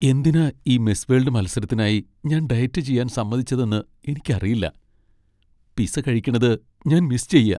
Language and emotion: Malayalam, sad